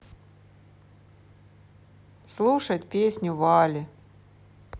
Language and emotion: Russian, neutral